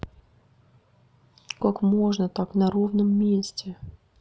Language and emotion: Russian, sad